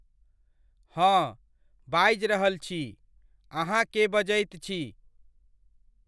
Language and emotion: Maithili, neutral